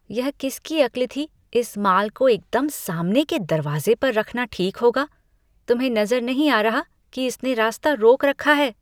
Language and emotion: Hindi, disgusted